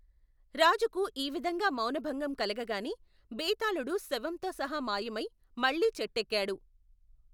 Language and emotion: Telugu, neutral